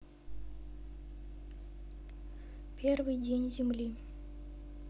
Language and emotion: Russian, neutral